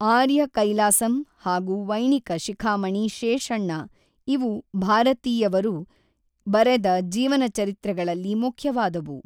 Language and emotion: Kannada, neutral